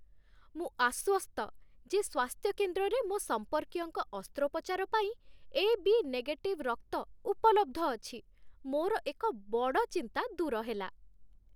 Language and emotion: Odia, happy